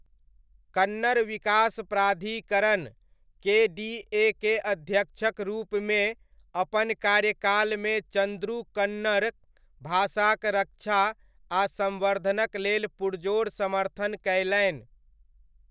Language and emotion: Maithili, neutral